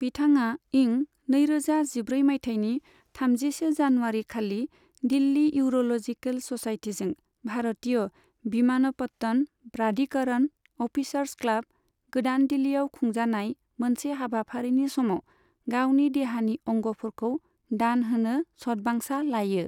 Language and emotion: Bodo, neutral